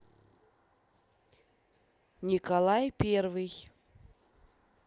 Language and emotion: Russian, neutral